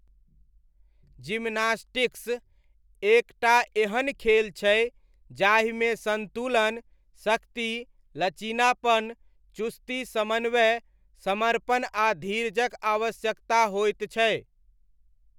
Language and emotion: Maithili, neutral